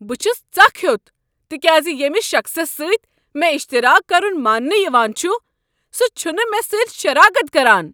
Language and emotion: Kashmiri, angry